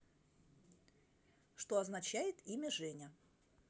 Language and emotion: Russian, neutral